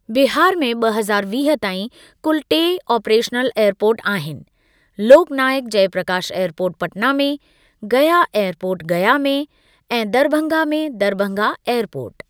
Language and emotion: Sindhi, neutral